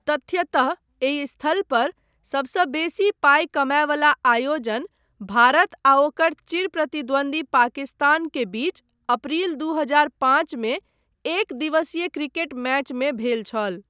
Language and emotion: Maithili, neutral